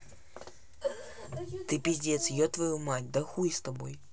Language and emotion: Russian, neutral